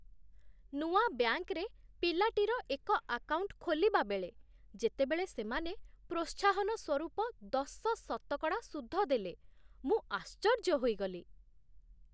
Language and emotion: Odia, surprised